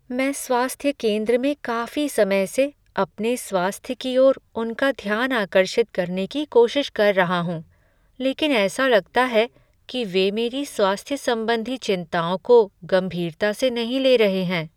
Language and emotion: Hindi, sad